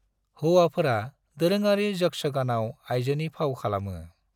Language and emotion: Bodo, neutral